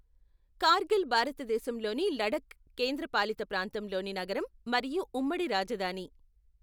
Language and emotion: Telugu, neutral